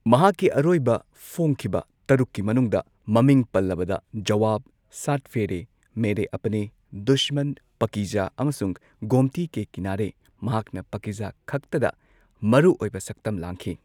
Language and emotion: Manipuri, neutral